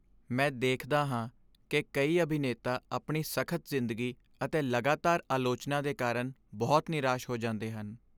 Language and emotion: Punjabi, sad